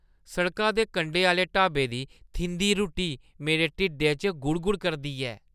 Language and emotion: Dogri, disgusted